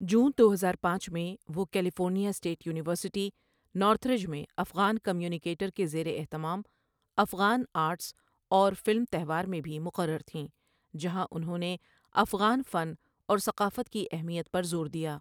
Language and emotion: Urdu, neutral